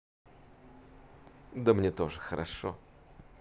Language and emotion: Russian, positive